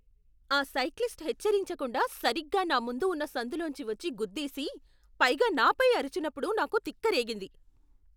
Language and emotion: Telugu, angry